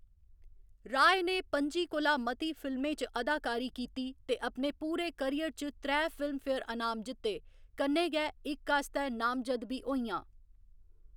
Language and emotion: Dogri, neutral